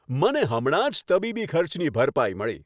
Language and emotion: Gujarati, happy